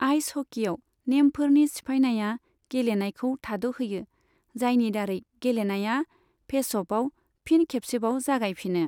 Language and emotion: Bodo, neutral